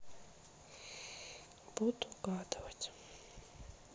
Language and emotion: Russian, sad